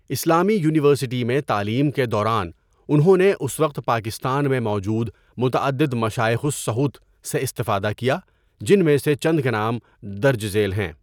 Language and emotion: Urdu, neutral